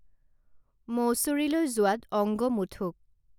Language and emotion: Assamese, neutral